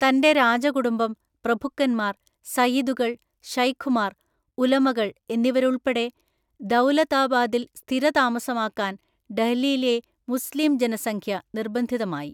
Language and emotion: Malayalam, neutral